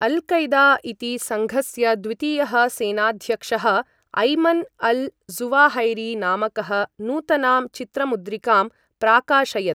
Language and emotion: Sanskrit, neutral